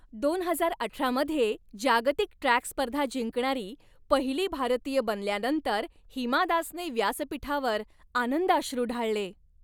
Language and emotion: Marathi, happy